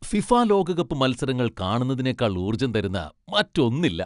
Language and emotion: Malayalam, happy